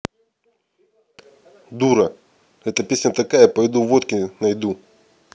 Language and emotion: Russian, angry